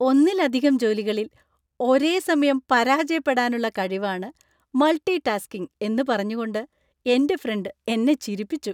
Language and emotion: Malayalam, happy